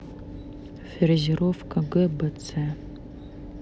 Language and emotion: Russian, neutral